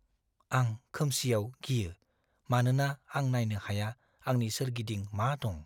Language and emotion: Bodo, fearful